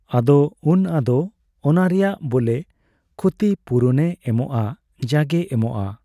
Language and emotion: Santali, neutral